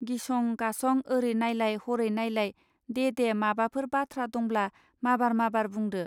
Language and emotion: Bodo, neutral